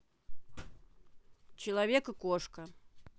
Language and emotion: Russian, neutral